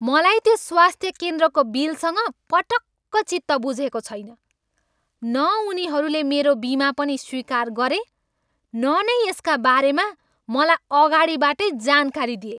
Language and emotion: Nepali, angry